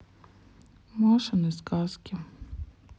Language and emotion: Russian, sad